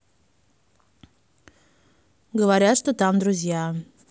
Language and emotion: Russian, neutral